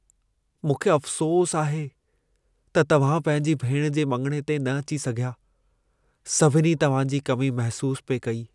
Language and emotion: Sindhi, sad